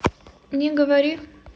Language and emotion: Russian, neutral